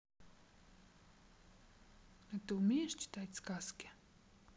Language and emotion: Russian, neutral